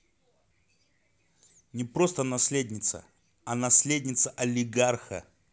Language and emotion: Russian, neutral